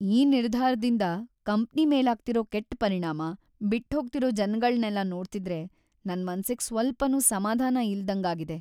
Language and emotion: Kannada, sad